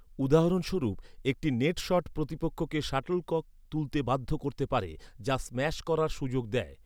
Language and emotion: Bengali, neutral